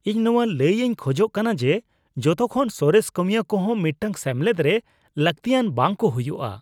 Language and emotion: Santali, disgusted